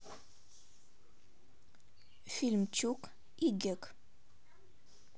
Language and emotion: Russian, neutral